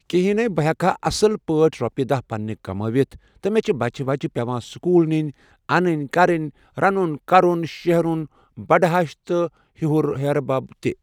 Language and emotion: Kashmiri, neutral